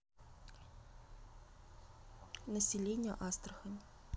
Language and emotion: Russian, neutral